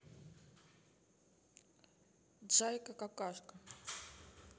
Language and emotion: Russian, neutral